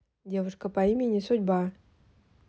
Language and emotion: Russian, neutral